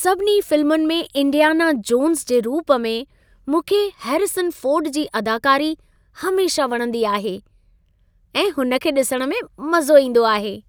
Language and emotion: Sindhi, happy